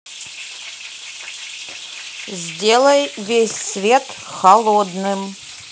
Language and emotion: Russian, neutral